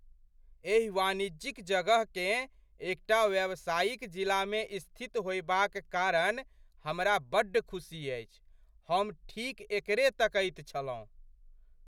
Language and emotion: Maithili, surprised